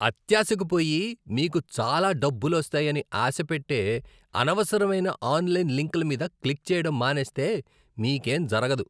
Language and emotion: Telugu, disgusted